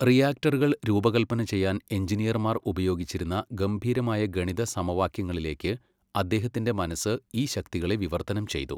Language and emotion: Malayalam, neutral